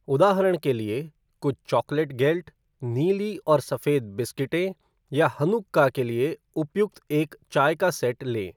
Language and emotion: Hindi, neutral